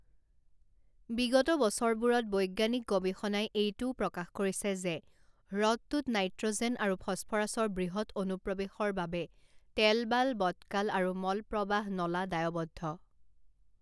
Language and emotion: Assamese, neutral